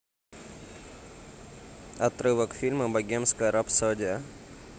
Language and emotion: Russian, neutral